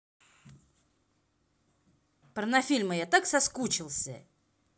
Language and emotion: Russian, angry